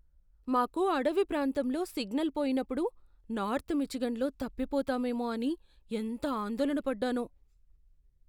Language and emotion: Telugu, fearful